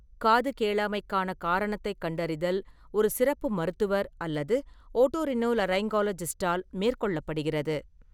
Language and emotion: Tamil, neutral